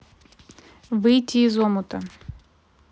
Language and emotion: Russian, neutral